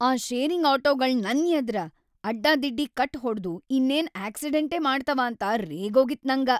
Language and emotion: Kannada, angry